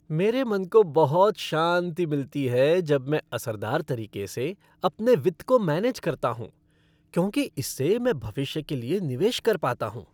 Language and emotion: Hindi, happy